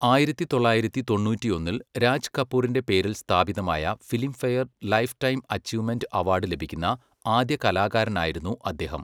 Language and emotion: Malayalam, neutral